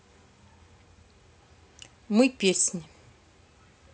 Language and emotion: Russian, neutral